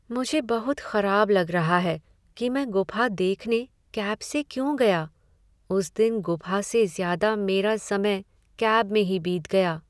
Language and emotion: Hindi, sad